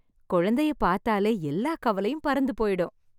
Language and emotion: Tamil, happy